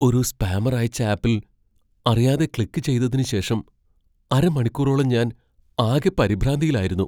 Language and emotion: Malayalam, fearful